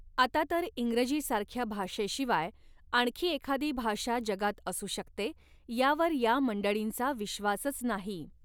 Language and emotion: Marathi, neutral